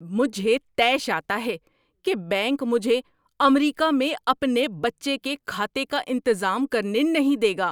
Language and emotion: Urdu, angry